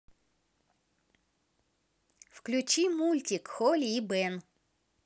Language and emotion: Russian, positive